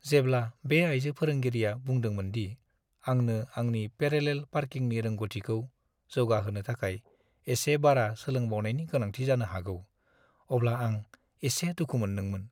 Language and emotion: Bodo, sad